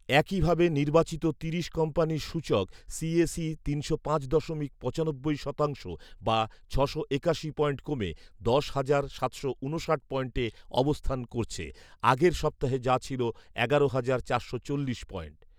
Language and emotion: Bengali, neutral